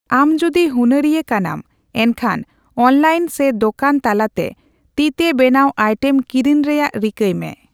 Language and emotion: Santali, neutral